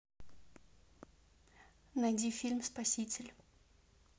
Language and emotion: Russian, neutral